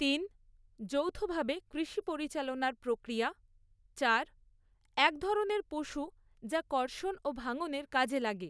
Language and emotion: Bengali, neutral